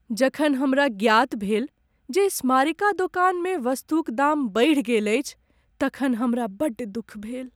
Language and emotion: Maithili, sad